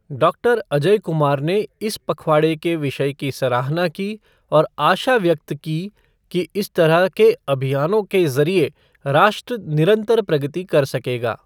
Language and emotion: Hindi, neutral